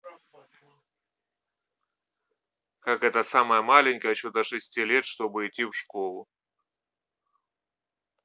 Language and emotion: Russian, neutral